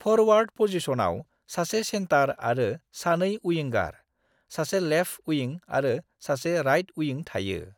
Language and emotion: Bodo, neutral